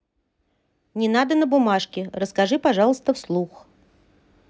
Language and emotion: Russian, neutral